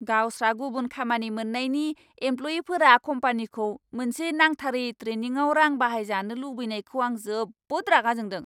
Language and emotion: Bodo, angry